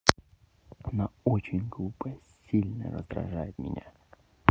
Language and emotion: Russian, neutral